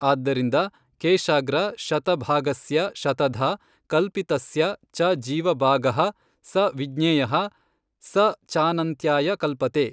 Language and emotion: Kannada, neutral